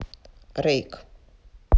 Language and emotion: Russian, neutral